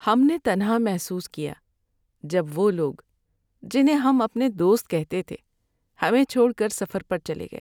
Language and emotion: Urdu, sad